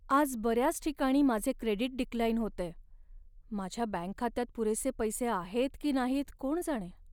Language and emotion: Marathi, sad